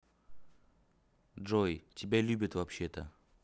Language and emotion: Russian, neutral